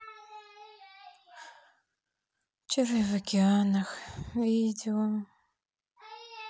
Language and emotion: Russian, sad